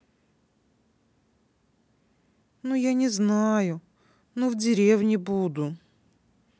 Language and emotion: Russian, sad